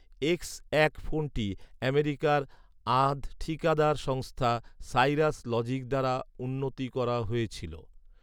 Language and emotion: Bengali, neutral